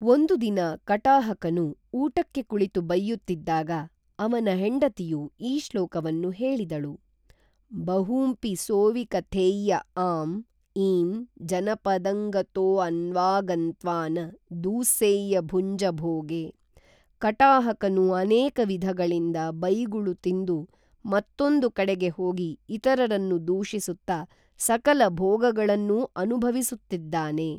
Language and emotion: Kannada, neutral